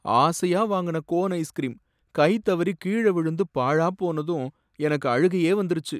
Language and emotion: Tamil, sad